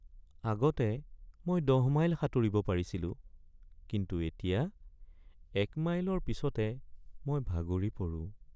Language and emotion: Assamese, sad